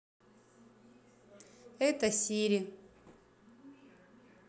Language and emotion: Russian, neutral